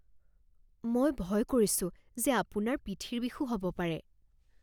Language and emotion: Assamese, fearful